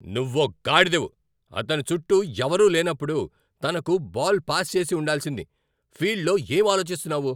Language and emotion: Telugu, angry